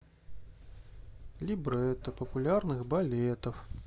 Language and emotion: Russian, sad